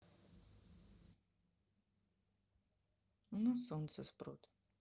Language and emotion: Russian, neutral